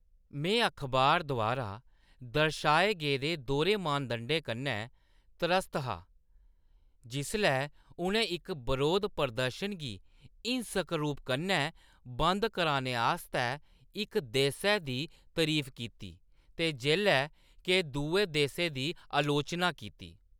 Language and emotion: Dogri, disgusted